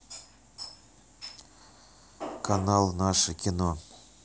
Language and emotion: Russian, neutral